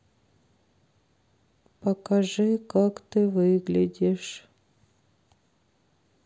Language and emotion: Russian, sad